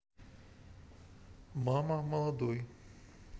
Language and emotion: Russian, neutral